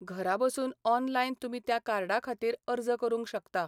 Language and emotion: Goan Konkani, neutral